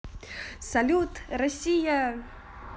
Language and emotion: Russian, positive